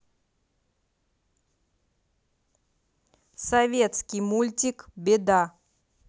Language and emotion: Russian, neutral